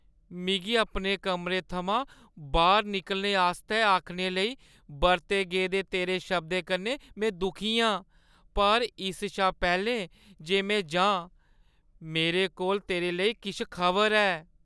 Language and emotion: Dogri, sad